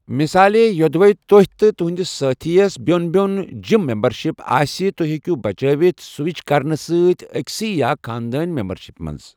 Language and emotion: Kashmiri, neutral